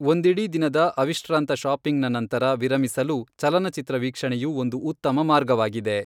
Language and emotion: Kannada, neutral